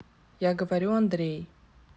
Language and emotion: Russian, neutral